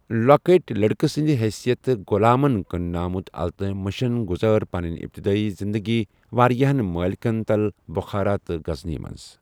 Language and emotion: Kashmiri, neutral